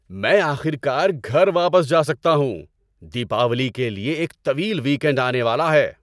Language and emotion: Urdu, happy